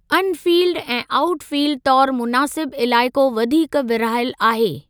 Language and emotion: Sindhi, neutral